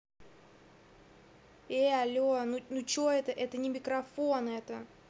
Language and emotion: Russian, angry